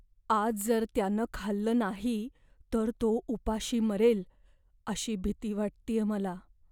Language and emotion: Marathi, fearful